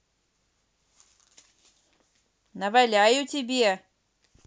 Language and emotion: Russian, angry